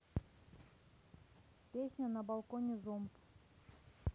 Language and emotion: Russian, neutral